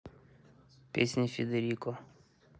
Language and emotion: Russian, neutral